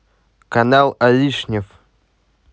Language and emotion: Russian, neutral